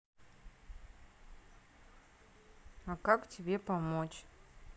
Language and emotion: Russian, neutral